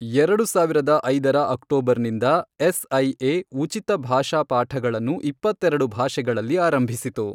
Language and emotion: Kannada, neutral